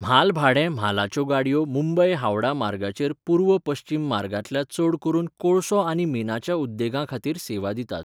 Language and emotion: Goan Konkani, neutral